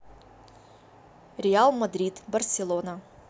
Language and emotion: Russian, neutral